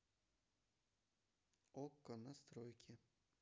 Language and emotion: Russian, neutral